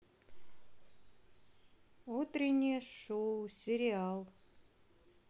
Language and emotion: Russian, neutral